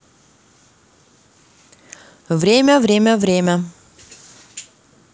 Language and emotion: Russian, neutral